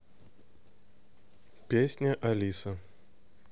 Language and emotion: Russian, neutral